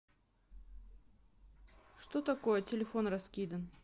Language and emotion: Russian, neutral